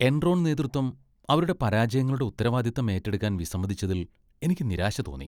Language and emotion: Malayalam, disgusted